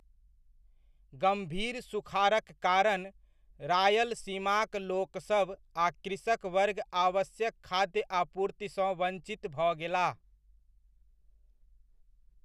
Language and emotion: Maithili, neutral